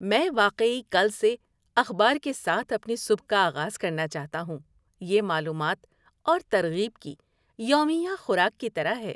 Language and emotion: Urdu, happy